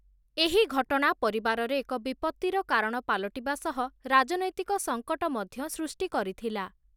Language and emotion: Odia, neutral